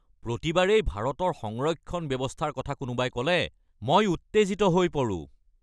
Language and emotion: Assamese, angry